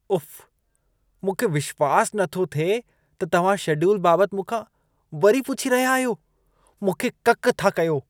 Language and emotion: Sindhi, disgusted